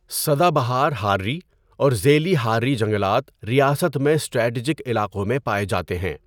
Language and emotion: Urdu, neutral